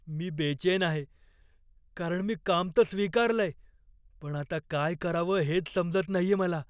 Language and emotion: Marathi, fearful